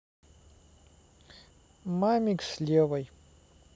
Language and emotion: Russian, neutral